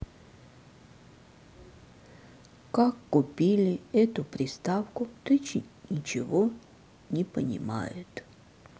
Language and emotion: Russian, sad